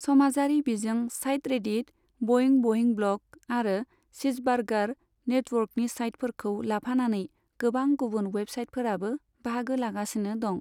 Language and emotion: Bodo, neutral